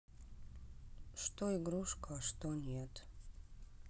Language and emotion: Russian, sad